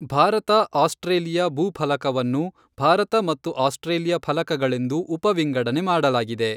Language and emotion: Kannada, neutral